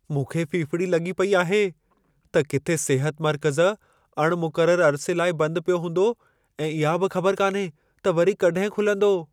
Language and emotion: Sindhi, fearful